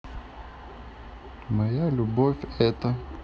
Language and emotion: Russian, neutral